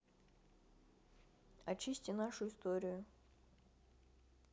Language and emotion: Russian, neutral